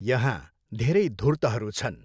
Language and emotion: Nepali, neutral